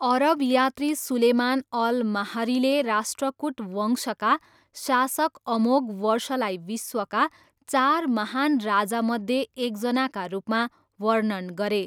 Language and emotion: Nepali, neutral